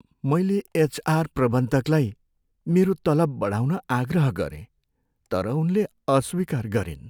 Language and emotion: Nepali, sad